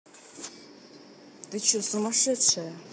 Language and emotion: Russian, angry